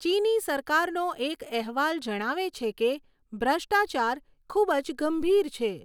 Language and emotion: Gujarati, neutral